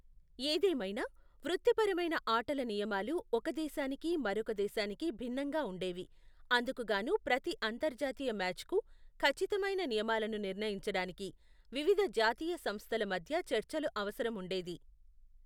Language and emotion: Telugu, neutral